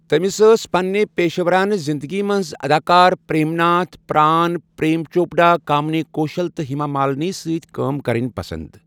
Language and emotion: Kashmiri, neutral